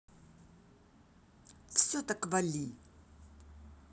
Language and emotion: Russian, angry